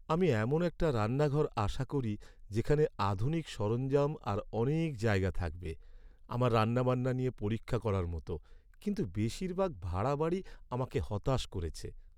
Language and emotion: Bengali, sad